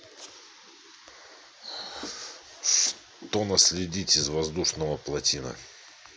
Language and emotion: Russian, neutral